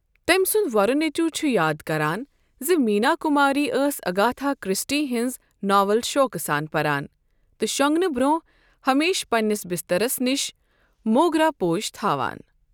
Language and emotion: Kashmiri, neutral